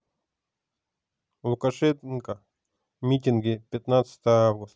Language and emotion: Russian, neutral